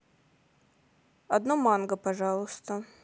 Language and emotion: Russian, neutral